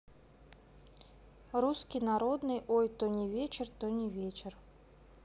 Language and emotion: Russian, neutral